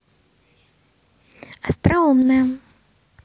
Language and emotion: Russian, positive